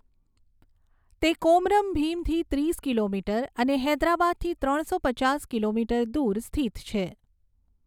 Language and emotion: Gujarati, neutral